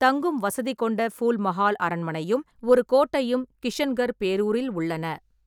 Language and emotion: Tamil, neutral